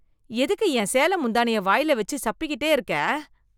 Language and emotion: Tamil, disgusted